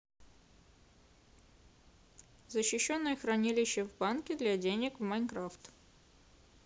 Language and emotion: Russian, neutral